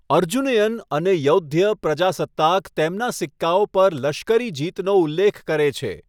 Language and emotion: Gujarati, neutral